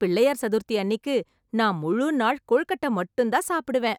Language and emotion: Tamil, happy